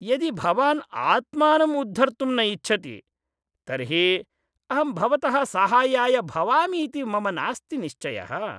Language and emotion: Sanskrit, disgusted